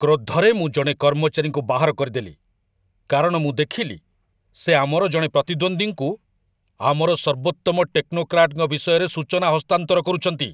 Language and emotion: Odia, angry